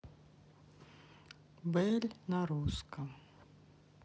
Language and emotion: Russian, neutral